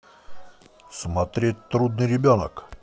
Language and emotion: Russian, neutral